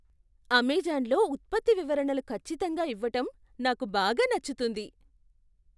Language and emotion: Telugu, surprised